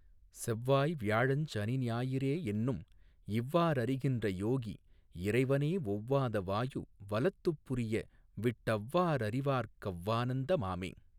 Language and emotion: Tamil, neutral